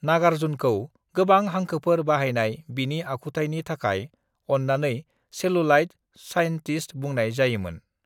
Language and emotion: Bodo, neutral